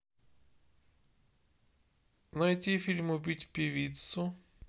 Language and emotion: Russian, neutral